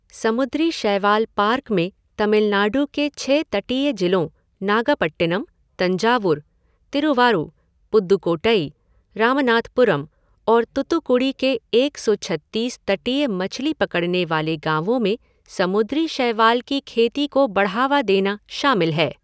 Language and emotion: Hindi, neutral